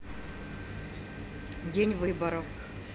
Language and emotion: Russian, neutral